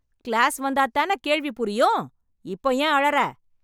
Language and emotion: Tamil, angry